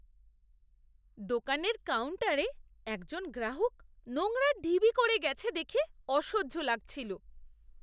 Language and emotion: Bengali, disgusted